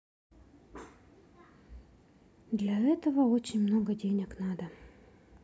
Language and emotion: Russian, sad